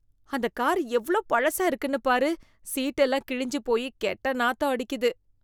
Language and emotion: Tamil, disgusted